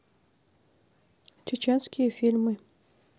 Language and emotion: Russian, neutral